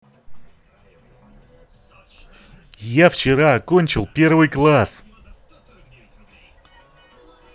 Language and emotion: Russian, positive